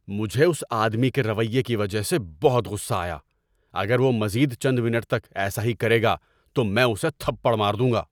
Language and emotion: Urdu, angry